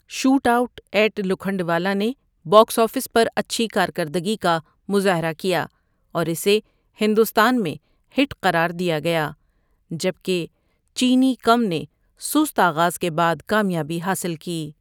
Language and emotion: Urdu, neutral